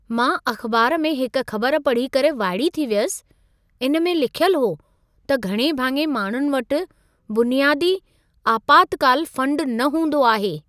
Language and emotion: Sindhi, surprised